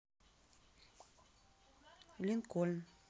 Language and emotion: Russian, neutral